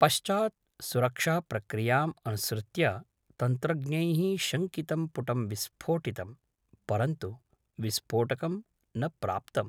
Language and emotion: Sanskrit, neutral